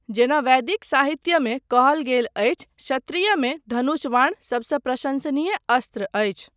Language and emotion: Maithili, neutral